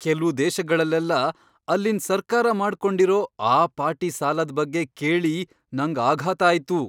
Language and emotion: Kannada, surprised